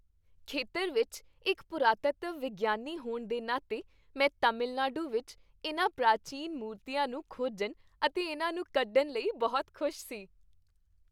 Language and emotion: Punjabi, happy